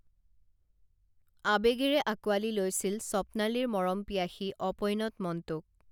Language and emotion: Assamese, neutral